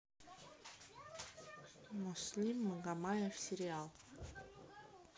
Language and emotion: Russian, neutral